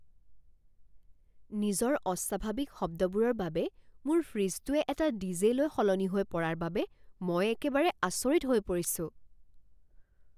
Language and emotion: Assamese, surprised